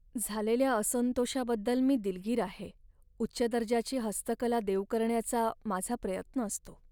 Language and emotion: Marathi, sad